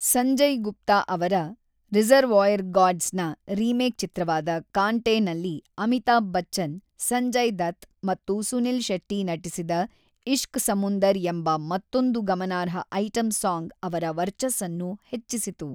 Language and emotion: Kannada, neutral